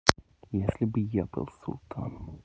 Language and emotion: Russian, neutral